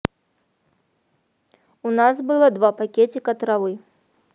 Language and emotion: Russian, neutral